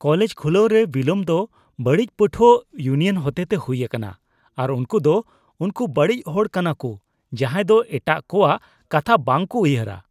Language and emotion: Santali, disgusted